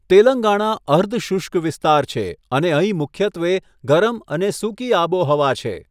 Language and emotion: Gujarati, neutral